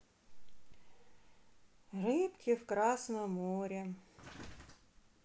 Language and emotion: Russian, sad